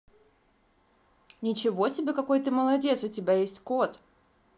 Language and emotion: Russian, positive